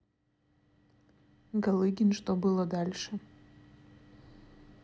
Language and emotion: Russian, neutral